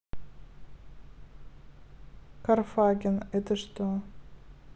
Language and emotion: Russian, neutral